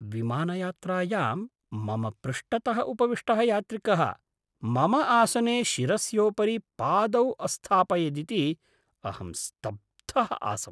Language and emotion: Sanskrit, surprised